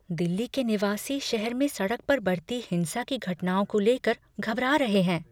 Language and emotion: Hindi, fearful